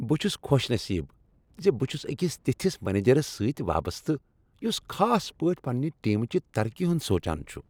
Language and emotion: Kashmiri, happy